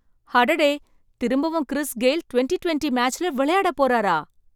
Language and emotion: Tamil, surprised